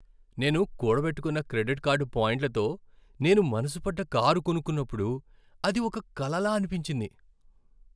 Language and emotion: Telugu, happy